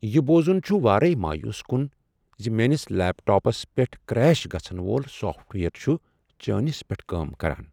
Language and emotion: Kashmiri, sad